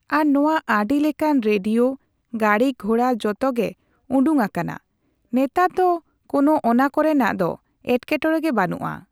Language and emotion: Santali, neutral